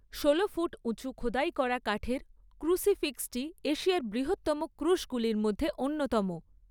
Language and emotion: Bengali, neutral